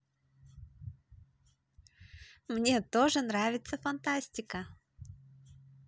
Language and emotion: Russian, positive